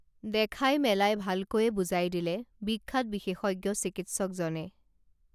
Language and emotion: Assamese, neutral